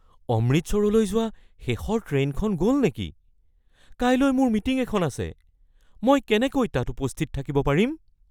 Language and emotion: Assamese, fearful